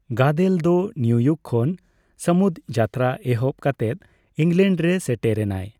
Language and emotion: Santali, neutral